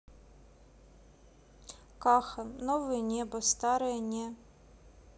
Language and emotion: Russian, neutral